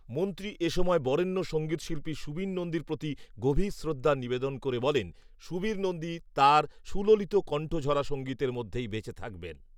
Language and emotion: Bengali, neutral